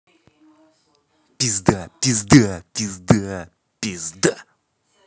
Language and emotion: Russian, angry